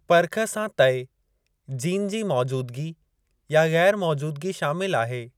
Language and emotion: Sindhi, neutral